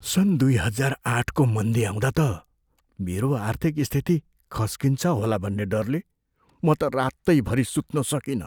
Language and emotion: Nepali, fearful